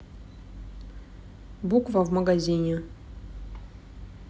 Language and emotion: Russian, neutral